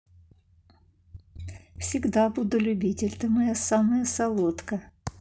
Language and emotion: Russian, positive